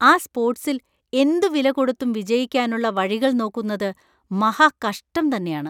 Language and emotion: Malayalam, disgusted